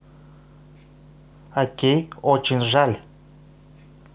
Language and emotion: Russian, neutral